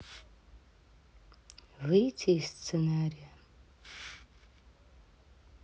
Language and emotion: Russian, sad